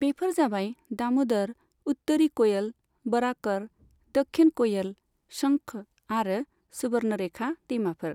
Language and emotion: Bodo, neutral